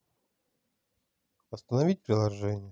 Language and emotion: Russian, sad